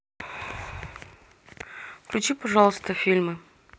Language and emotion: Russian, neutral